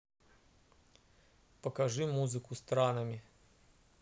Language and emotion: Russian, neutral